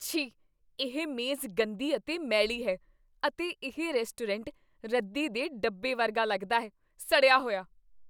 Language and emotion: Punjabi, disgusted